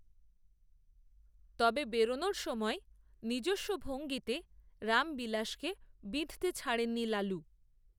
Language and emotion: Bengali, neutral